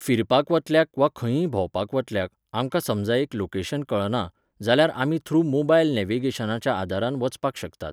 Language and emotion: Goan Konkani, neutral